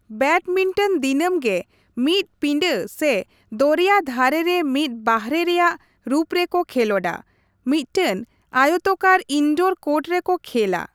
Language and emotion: Santali, neutral